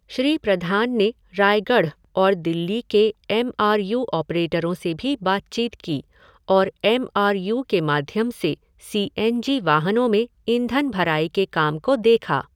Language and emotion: Hindi, neutral